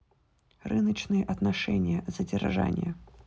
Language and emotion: Russian, neutral